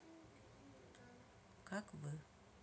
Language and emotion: Russian, neutral